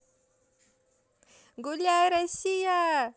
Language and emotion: Russian, positive